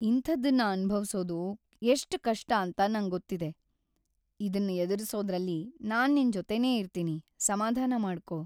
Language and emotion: Kannada, sad